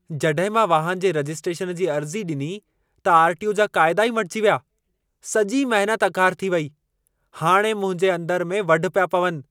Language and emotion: Sindhi, angry